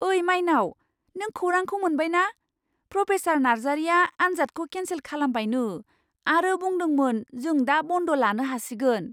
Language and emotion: Bodo, surprised